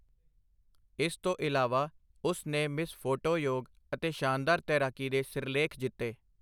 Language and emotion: Punjabi, neutral